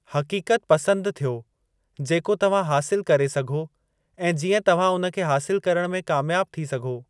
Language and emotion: Sindhi, neutral